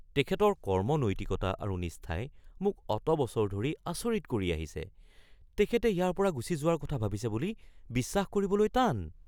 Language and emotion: Assamese, surprised